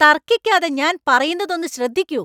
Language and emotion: Malayalam, angry